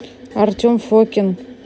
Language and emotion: Russian, neutral